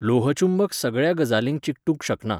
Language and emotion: Goan Konkani, neutral